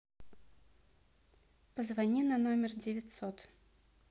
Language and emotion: Russian, neutral